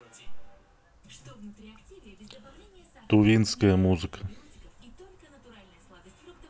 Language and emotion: Russian, neutral